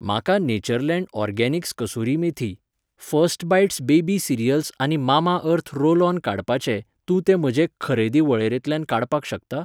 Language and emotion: Goan Konkani, neutral